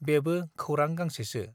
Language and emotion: Bodo, neutral